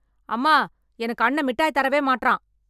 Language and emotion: Tamil, angry